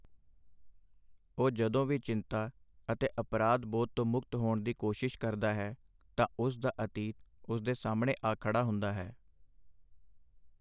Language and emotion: Punjabi, neutral